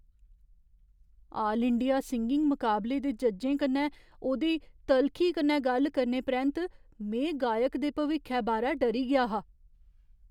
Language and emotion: Dogri, fearful